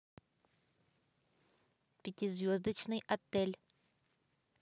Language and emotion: Russian, neutral